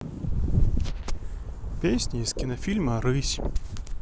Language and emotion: Russian, neutral